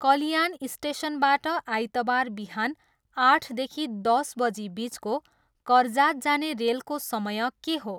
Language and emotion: Nepali, neutral